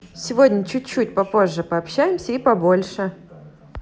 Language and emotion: Russian, positive